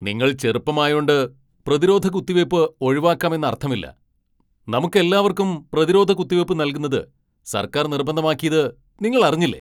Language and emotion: Malayalam, angry